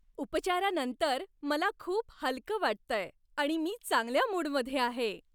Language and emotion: Marathi, happy